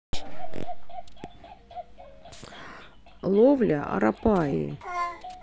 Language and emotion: Russian, neutral